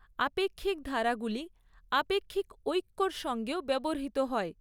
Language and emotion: Bengali, neutral